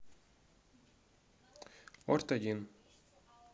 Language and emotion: Russian, neutral